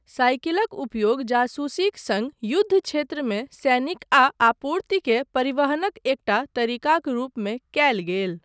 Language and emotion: Maithili, neutral